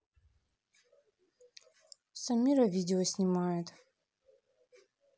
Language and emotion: Russian, neutral